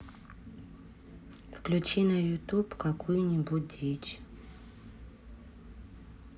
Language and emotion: Russian, neutral